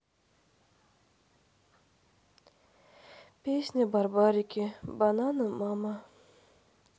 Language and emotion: Russian, sad